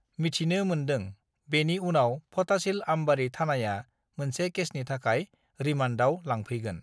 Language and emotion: Bodo, neutral